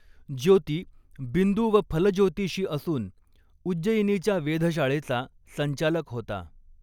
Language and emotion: Marathi, neutral